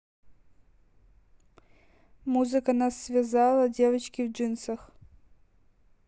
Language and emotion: Russian, neutral